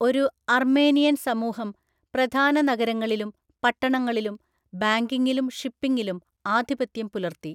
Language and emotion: Malayalam, neutral